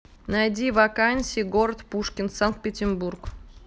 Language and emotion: Russian, neutral